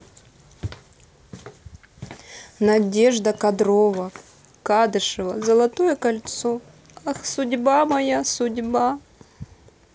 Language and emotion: Russian, sad